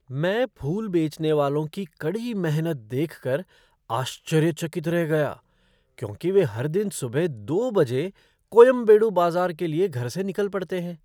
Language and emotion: Hindi, surprised